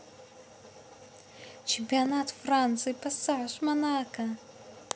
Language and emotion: Russian, positive